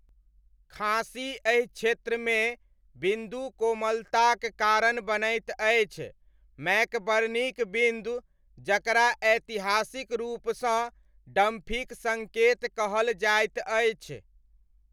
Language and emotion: Maithili, neutral